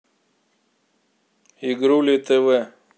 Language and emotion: Russian, neutral